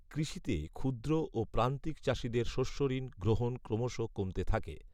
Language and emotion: Bengali, neutral